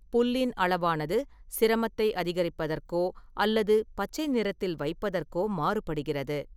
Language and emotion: Tamil, neutral